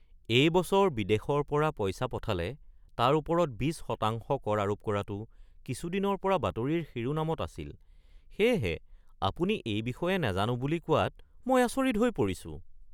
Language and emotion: Assamese, surprised